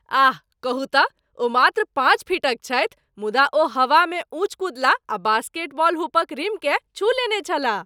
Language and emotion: Maithili, surprised